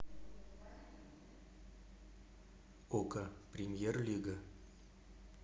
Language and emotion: Russian, neutral